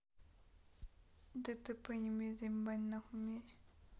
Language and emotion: Russian, neutral